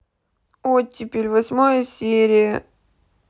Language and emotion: Russian, sad